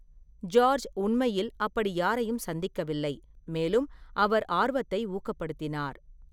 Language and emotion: Tamil, neutral